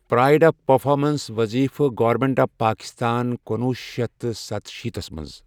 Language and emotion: Kashmiri, neutral